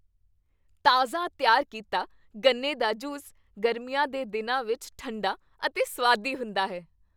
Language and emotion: Punjabi, happy